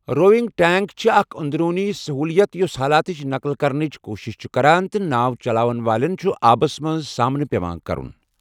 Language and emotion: Kashmiri, neutral